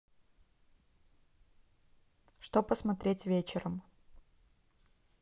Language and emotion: Russian, neutral